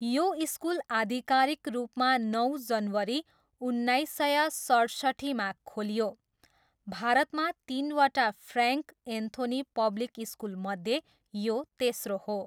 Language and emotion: Nepali, neutral